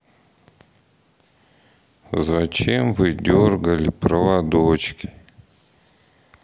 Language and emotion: Russian, sad